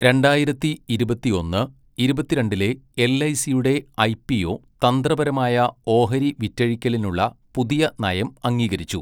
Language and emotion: Malayalam, neutral